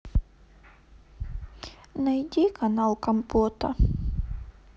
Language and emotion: Russian, sad